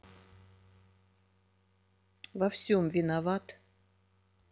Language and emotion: Russian, neutral